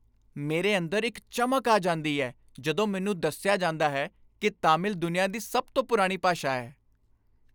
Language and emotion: Punjabi, happy